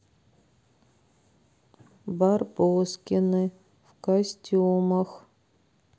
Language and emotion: Russian, sad